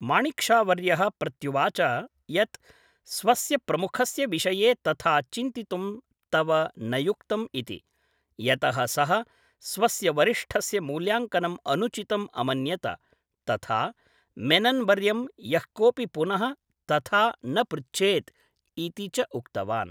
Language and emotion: Sanskrit, neutral